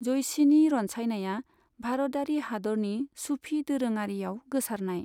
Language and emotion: Bodo, neutral